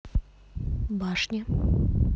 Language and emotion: Russian, neutral